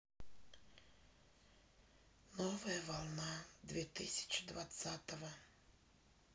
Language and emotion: Russian, sad